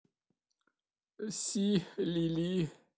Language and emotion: Russian, sad